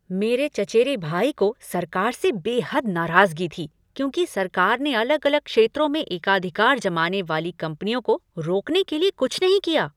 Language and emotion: Hindi, angry